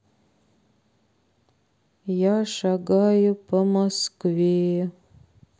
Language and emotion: Russian, sad